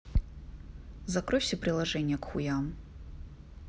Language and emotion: Russian, neutral